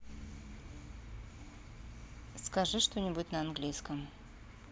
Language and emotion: Russian, neutral